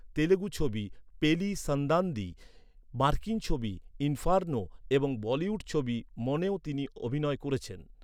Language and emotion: Bengali, neutral